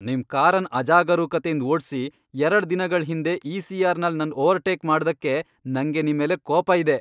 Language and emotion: Kannada, angry